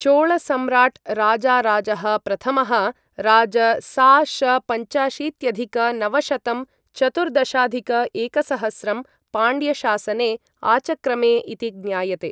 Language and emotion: Sanskrit, neutral